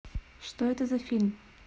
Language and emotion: Russian, neutral